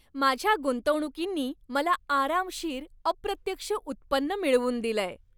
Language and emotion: Marathi, happy